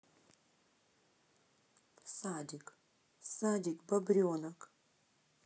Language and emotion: Russian, neutral